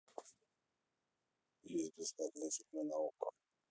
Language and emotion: Russian, neutral